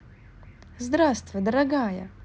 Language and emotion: Russian, positive